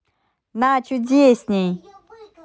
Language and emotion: Russian, positive